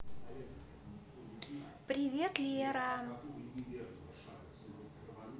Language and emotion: Russian, positive